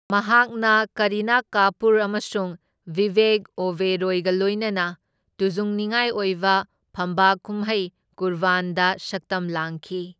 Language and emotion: Manipuri, neutral